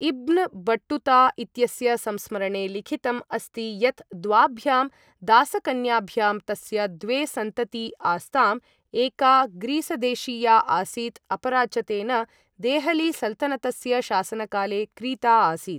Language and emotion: Sanskrit, neutral